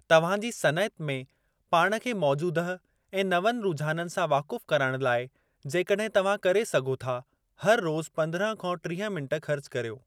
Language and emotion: Sindhi, neutral